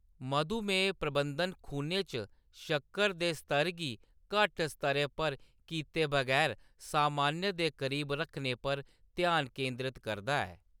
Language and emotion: Dogri, neutral